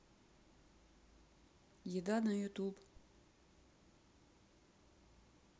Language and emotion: Russian, neutral